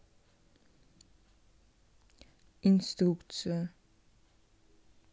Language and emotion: Russian, neutral